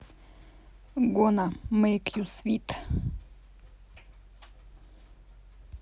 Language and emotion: Russian, neutral